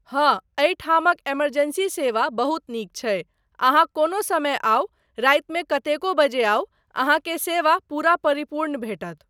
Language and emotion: Maithili, neutral